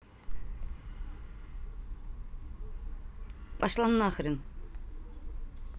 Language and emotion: Russian, angry